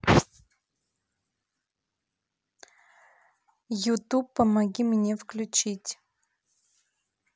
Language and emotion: Russian, neutral